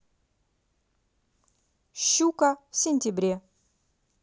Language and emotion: Russian, positive